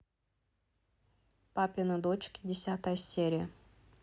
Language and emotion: Russian, neutral